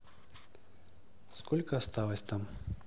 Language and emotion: Russian, neutral